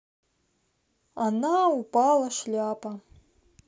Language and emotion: Russian, neutral